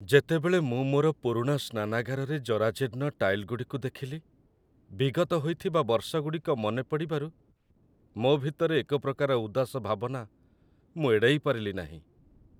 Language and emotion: Odia, sad